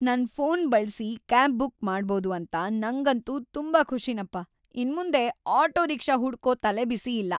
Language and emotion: Kannada, happy